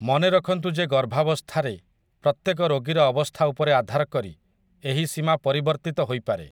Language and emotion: Odia, neutral